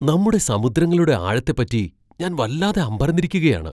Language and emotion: Malayalam, surprised